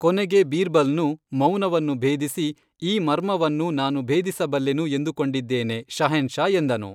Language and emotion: Kannada, neutral